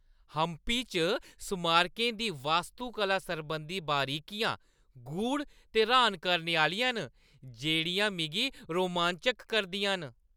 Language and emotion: Dogri, happy